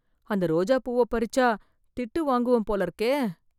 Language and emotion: Tamil, fearful